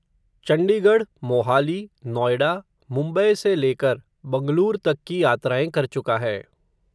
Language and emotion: Hindi, neutral